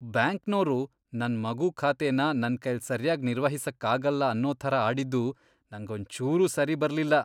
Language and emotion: Kannada, disgusted